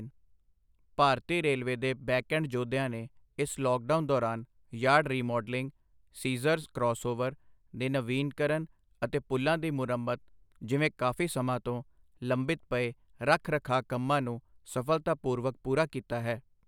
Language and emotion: Punjabi, neutral